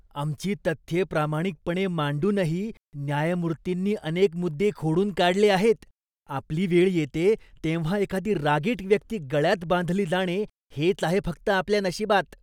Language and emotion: Marathi, disgusted